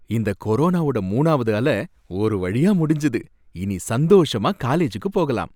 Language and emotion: Tamil, happy